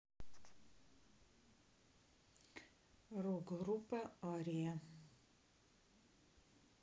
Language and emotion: Russian, neutral